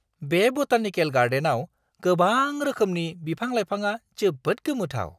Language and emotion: Bodo, surprised